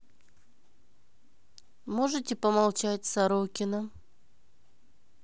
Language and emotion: Russian, neutral